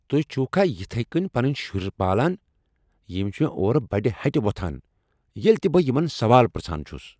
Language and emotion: Kashmiri, angry